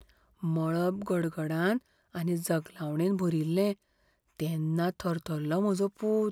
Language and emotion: Goan Konkani, fearful